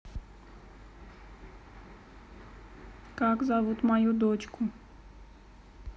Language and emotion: Russian, neutral